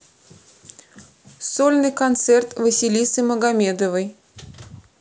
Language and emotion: Russian, neutral